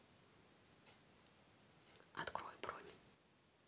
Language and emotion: Russian, neutral